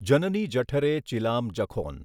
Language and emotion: Gujarati, neutral